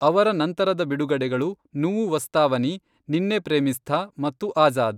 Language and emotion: Kannada, neutral